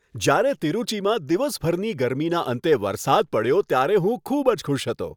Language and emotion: Gujarati, happy